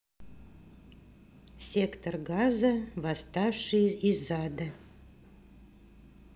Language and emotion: Russian, neutral